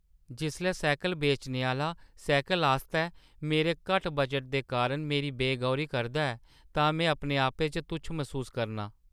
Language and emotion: Dogri, sad